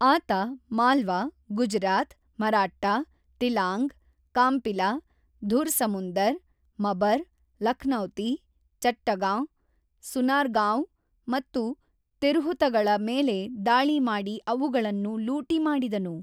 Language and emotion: Kannada, neutral